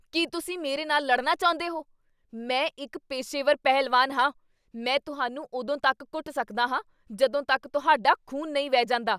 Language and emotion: Punjabi, angry